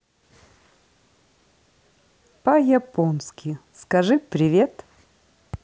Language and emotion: Russian, positive